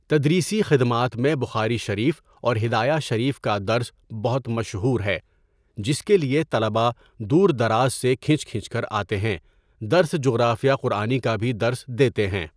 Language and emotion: Urdu, neutral